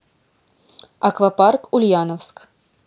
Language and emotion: Russian, neutral